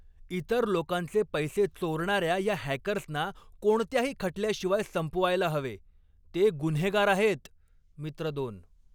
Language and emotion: Marathi, angry